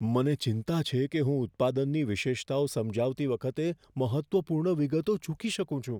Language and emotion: Gujarati, fearful